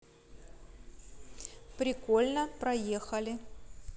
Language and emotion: Russian, neutral